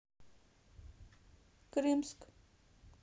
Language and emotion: Russian, neutral